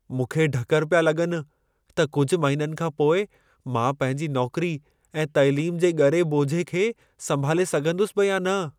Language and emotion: Sindhi, fearful